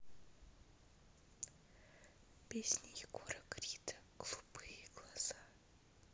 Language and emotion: Russian, neutral